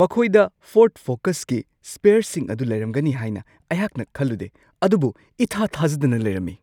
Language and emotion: Manipuri, surprised